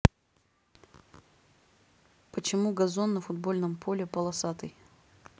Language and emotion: Russian, neutral